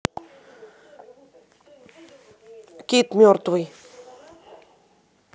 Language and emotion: Russian, neutral